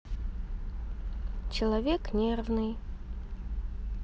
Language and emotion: Russian, neutral